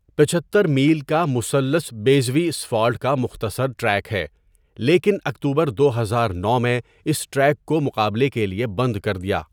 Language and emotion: Urdu, neutral